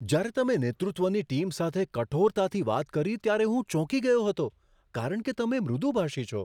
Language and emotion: Gujarati, surprised